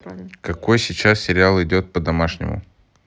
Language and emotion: Russian, neutral